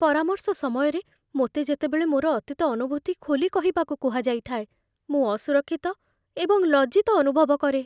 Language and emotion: Odia, fearful